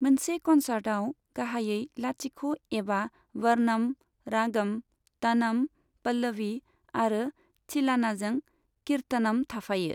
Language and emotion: Bodo, neutral